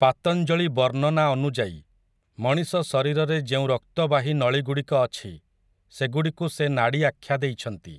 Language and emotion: Odia, neutral